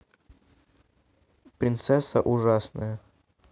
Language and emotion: Russian, neutral